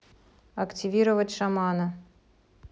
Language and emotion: Russian, neutral